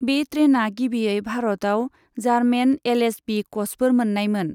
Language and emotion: Bodo, neutral